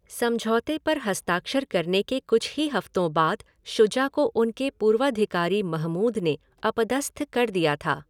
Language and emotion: Hindi, neutral